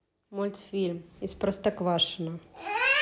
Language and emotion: Russian, neutral